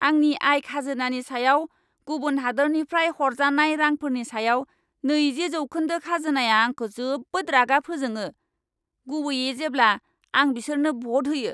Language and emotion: Bodo, angry